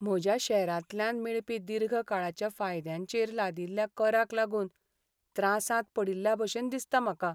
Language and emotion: Goan Konkani, sad